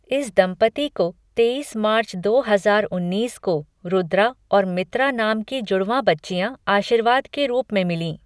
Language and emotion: Hindi, neutral